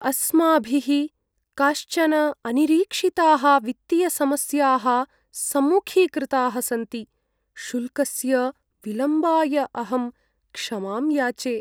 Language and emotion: Sanskrit, sad